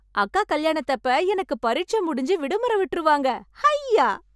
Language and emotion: Tamil, happy